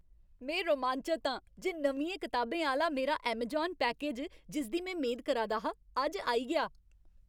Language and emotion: Dogri, happy